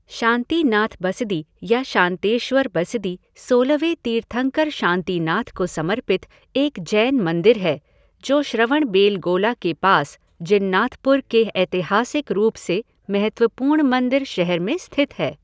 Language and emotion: Hindi, neutral